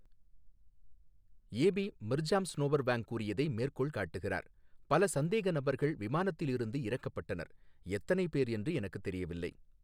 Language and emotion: Tamil, neutral